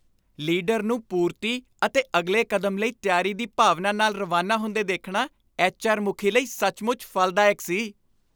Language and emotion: Punjabi, happy